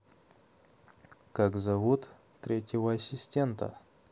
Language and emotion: Russian, neutral